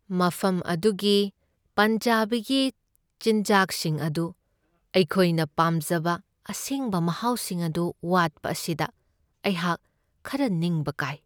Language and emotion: Manipuri, sad